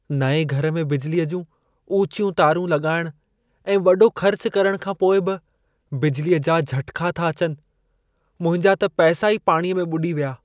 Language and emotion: Sindhi, sad